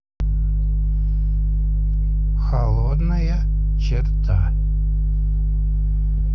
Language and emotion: Russian, neutral